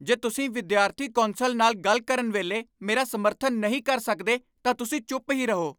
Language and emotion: Punjabi, angry